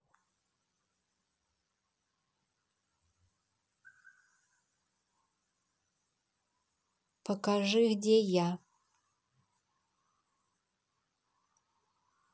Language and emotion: Russian, neutral